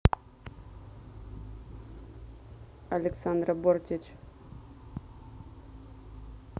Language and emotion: Russian, neutral